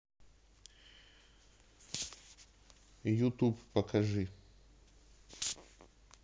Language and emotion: Russian, neutral